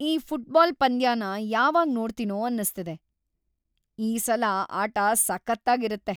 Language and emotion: Kannada, happy